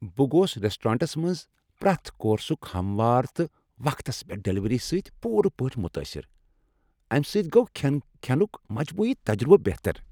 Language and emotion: Kashmiri, happy